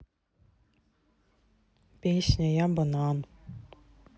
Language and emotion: Russian, neutral